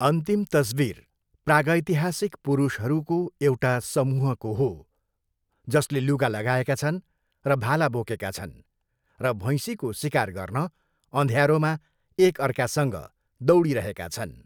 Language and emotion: Nepali, neutral